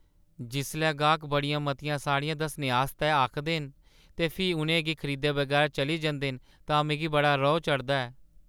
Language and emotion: Dogri, sad